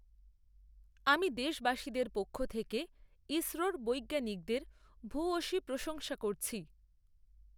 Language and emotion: Bengali, neutral